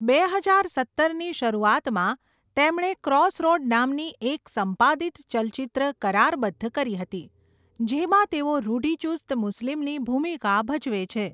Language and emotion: Gujarati, neutral